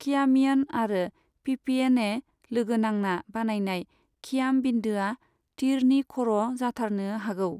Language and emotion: Bodo, neutral